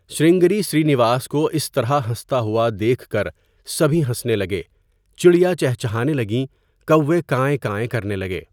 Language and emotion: Urdu, neutral